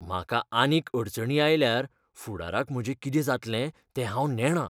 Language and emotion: Goan Konkani, fearful